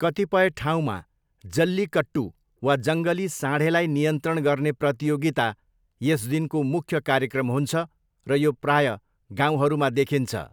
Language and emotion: Nepali, neutral